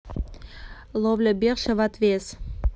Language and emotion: Russian, neutral